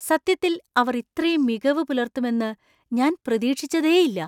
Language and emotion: Malayalam, surprised